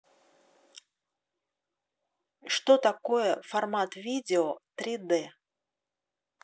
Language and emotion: Russian, neutral